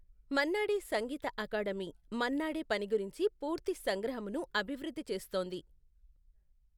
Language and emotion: Telugu, neutral